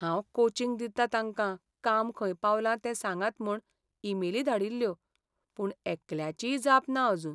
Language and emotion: Goan Konkani, sad